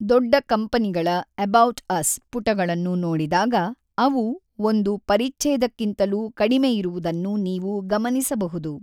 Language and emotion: Kannada, neutral